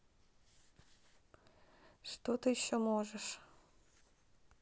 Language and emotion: Russian, neutral